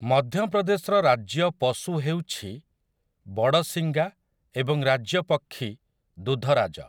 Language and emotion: Odia, neutral